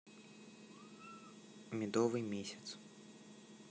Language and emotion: Russian, neutral